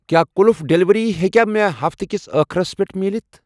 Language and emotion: Kashmiri, neutral